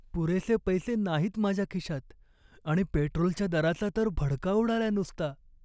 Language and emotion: Marathi, sad